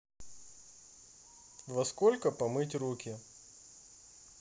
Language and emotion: Russian, neutral